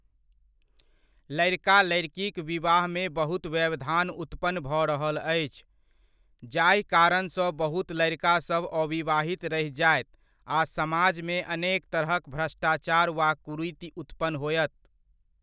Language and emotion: Maithili, neutral